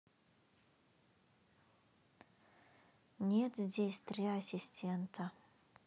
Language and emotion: Russian, sad